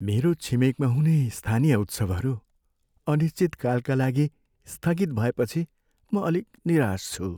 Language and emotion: Nepali, sad